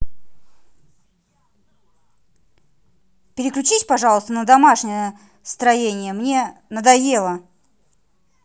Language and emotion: Russian, angry